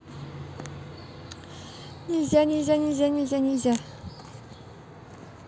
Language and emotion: Russian, positive